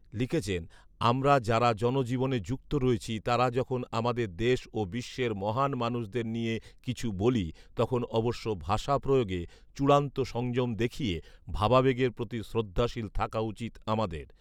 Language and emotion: Bengali, neutral